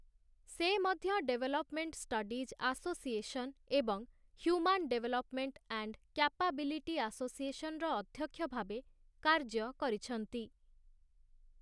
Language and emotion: Odia, neutral